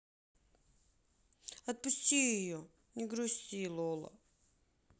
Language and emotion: Russian, sad